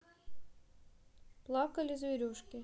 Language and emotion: Russian, neutral